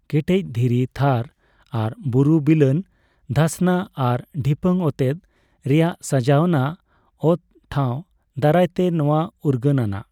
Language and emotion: Santali, neutral